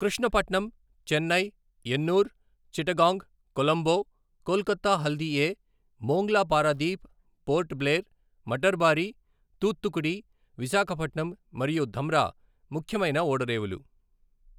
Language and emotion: Telugu, neutral